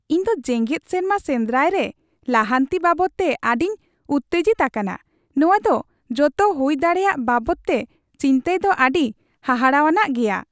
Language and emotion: Santali, happy